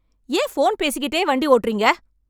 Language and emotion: Tamil, angry